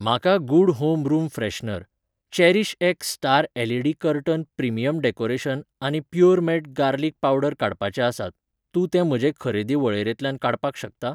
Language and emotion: Goan Konkani, neutral